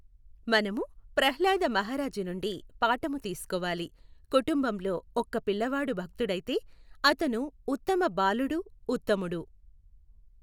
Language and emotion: Telugu, neutral